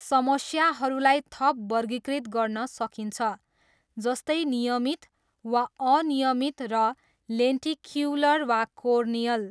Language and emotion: Nepali, neutral